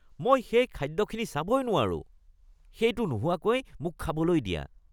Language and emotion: Assamese, disgusted